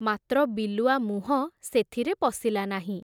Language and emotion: Odia, neutral